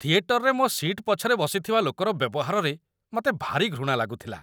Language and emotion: Odia, disgusted